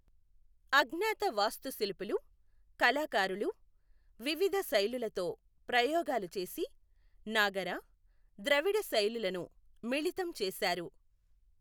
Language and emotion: Telugu, neutral